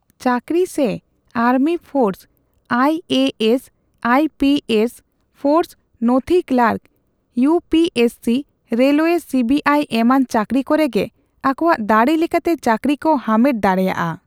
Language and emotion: Santali, neutral